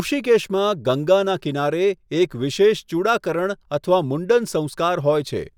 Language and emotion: Gujarati, neutral